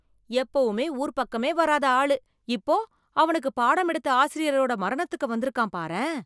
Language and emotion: Tamil, surprised